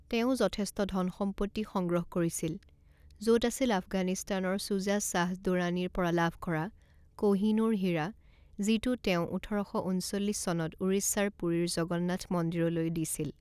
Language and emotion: Assamese, neutral